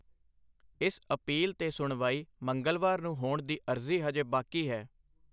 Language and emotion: Punjabi, neutral